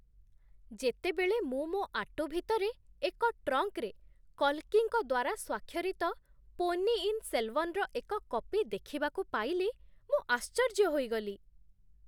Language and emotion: Odia, surprised